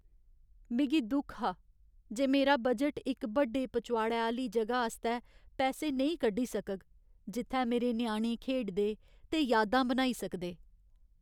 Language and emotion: Dogri, sad